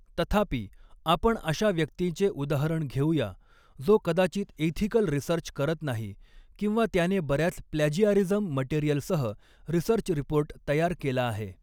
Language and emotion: Marathi, neutral